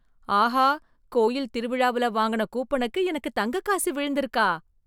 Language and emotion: Tamil, surprised